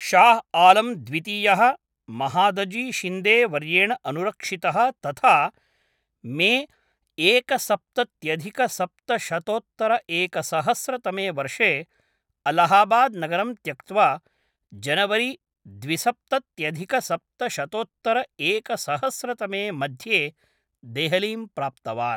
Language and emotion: Sanskrit, neutral